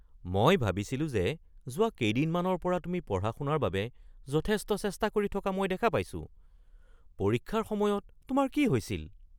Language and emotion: Assamese, surprised